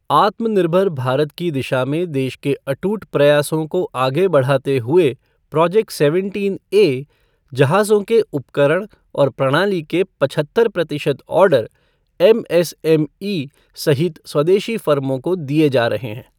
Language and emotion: Hindi, neutral